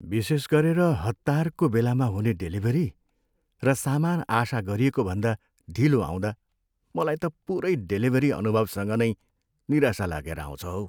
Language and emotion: Nepali, sad